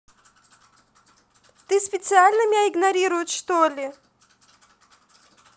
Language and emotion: Russian, angry